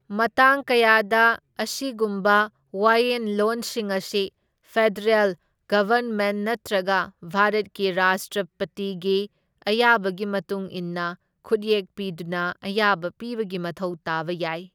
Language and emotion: Manipuri, neutral